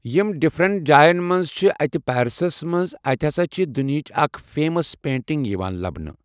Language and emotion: Kashmiri, neutral